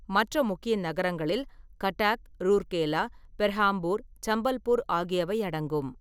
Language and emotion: Tamil, neutral